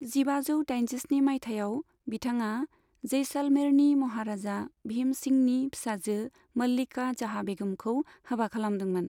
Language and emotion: Bodo, neutral